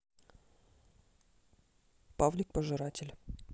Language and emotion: Russian, neutral